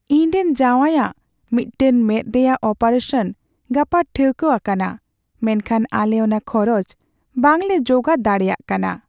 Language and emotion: Santali, sad